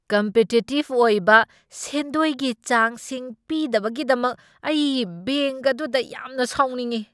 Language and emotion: Manipuri, angry